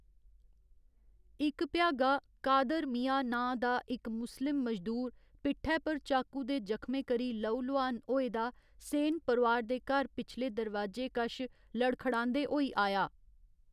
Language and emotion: Dogri, neutral